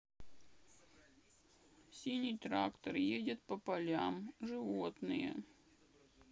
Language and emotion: Russian, sad